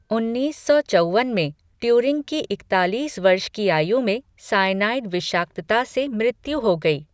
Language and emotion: Hindi, neutral